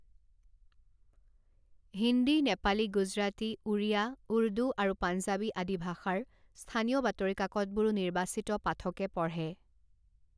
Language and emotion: Assamese, neutral